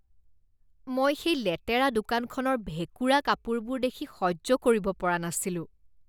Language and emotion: Assamese, disgusted